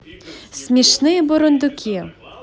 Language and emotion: Russian, positive